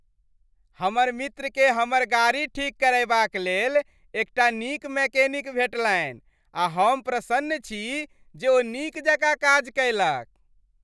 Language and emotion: Maithili, happy